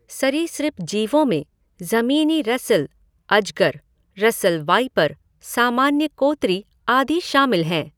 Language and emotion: Hindi, neutral